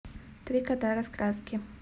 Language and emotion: Russian, neutral